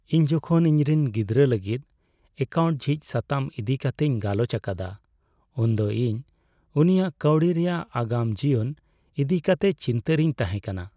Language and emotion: Santali, sad